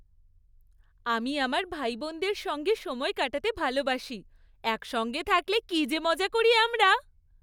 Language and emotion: Bengali, happy